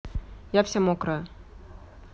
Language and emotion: Russian, neutral